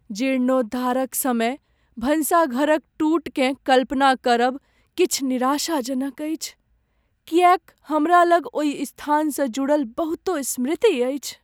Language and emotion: Maithili, sad